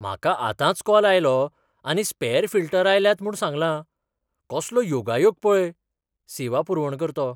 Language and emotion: Goan Konkani, surprised